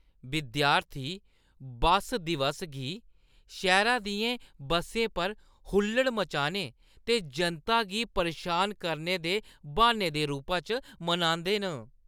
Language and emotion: Dogri, disgusted